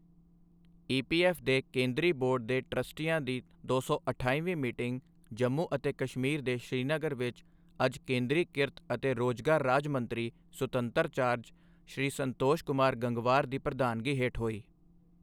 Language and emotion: Punjabi, neutral